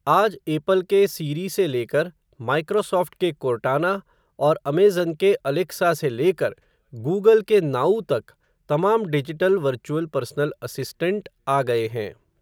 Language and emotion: Hindi, neutral